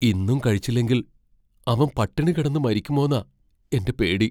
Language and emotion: Malayalam, fearful